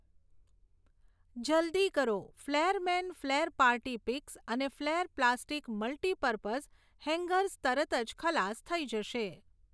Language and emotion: Gujarati, neutral